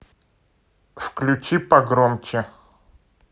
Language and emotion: Russian, neutral